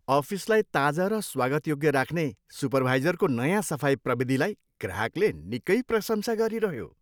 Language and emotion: Nepali, happy